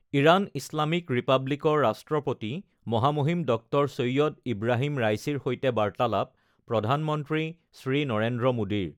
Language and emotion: Assamese, neutral